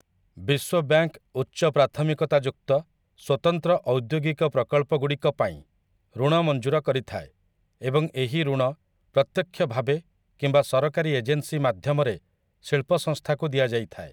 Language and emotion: Odia, neutral